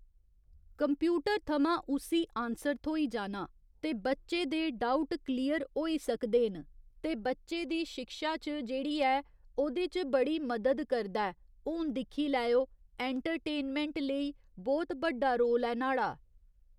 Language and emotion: Dogri, neutral